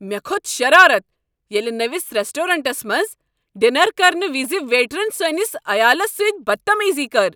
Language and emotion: Kashmiri, angry